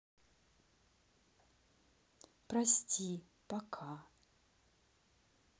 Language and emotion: Russian, sad